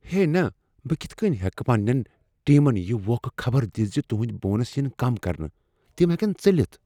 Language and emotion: Kashmiri, fearful